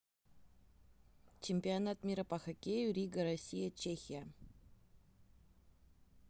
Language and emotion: Russian, neutral